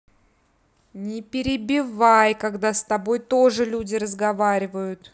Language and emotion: Russian, angry